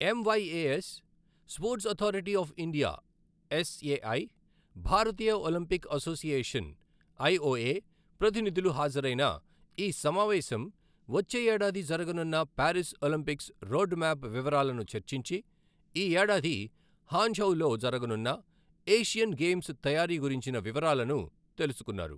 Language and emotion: Telugu, neutral